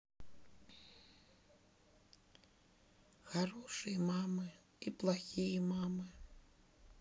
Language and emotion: Russian, sad